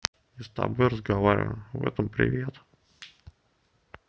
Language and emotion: Russian, neutral